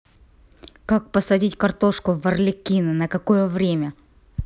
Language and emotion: Russian, angry